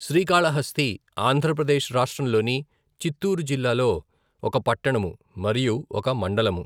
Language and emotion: Telugu, neutral